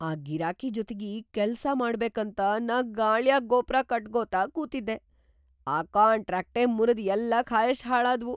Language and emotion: Kannada, surprised